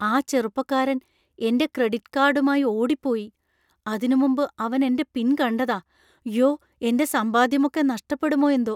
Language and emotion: Malayalam, fearful